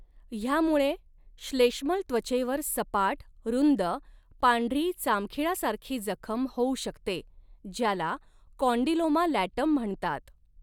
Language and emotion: Marathi, neutral